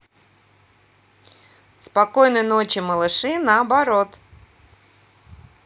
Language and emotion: Russian, positive